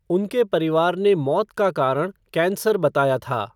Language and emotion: Hindi, neutral